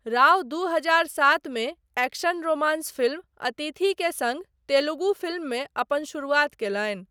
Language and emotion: Maithili, neutral